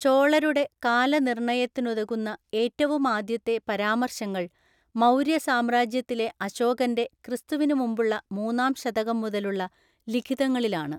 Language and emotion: Malayalam, neutral